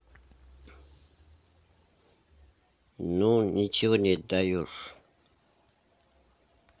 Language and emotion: Russian, neutral